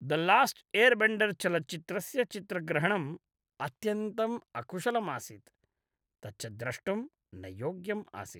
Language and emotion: Sanskrit, disgusted